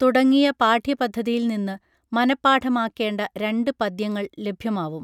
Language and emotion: Malayalam, neutral